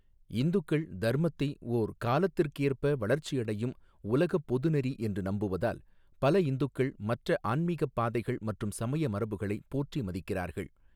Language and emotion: Tamil, neutral